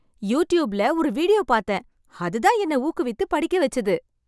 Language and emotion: Tamil, happy